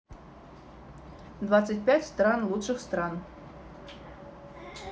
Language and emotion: Russian, neutral